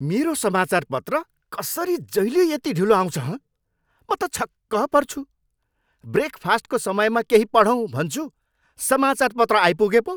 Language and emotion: Nepali, angry